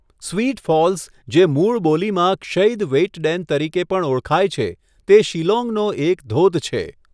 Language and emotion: Gujarati, neutral